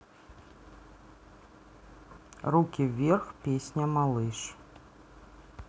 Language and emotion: Russian, neutral